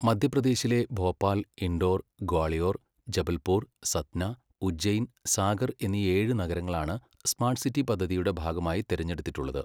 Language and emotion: Malayalam, neutral